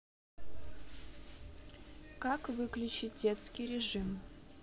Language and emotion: Russian, neutral